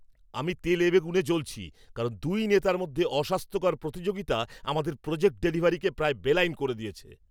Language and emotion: Bengali, angry